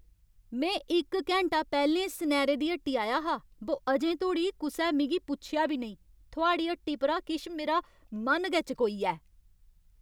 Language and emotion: Dogri, angry